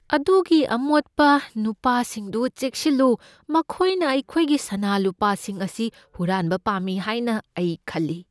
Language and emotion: Manipuri, fearful